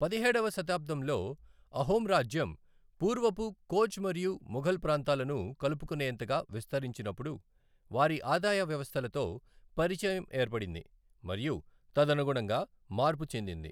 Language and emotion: Telugu, neutral